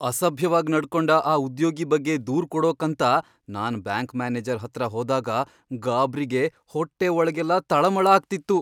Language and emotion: Kannada, fearful